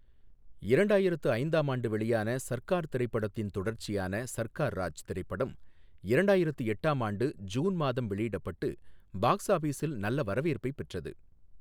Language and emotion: Tamil, neutral